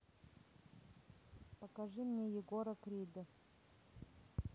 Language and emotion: Russian, neutral